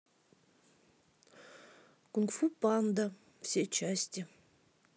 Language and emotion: Russian, sad